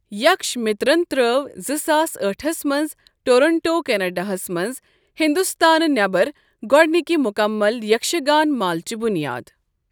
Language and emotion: Kashmiri, neutral